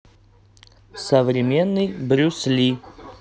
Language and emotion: Russian, neutral